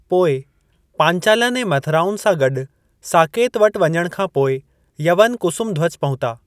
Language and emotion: Sindhi, neutral